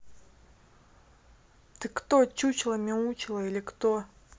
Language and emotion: Russian, angry